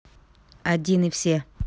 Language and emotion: Russian, neutral